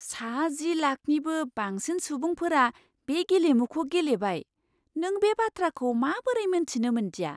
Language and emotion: Bodo, surprised